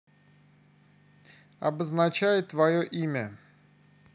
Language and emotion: Russian, neutral